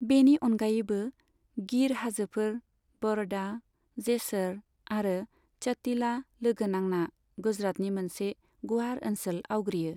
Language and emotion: Bodo, neutral